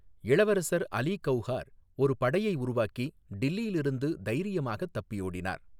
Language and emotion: Tamil, neutral